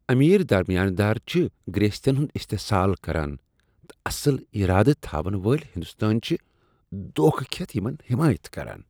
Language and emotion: Kashmiri, disgusted